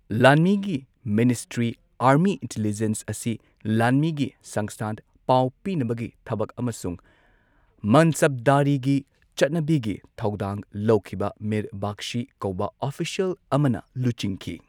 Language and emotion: Manipuri, neutral